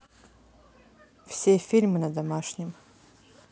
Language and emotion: Russian, neutral